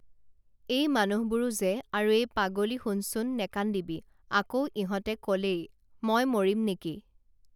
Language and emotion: Assamese, neutral